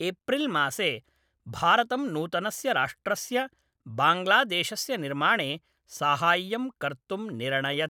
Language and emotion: Sanskrit, neutral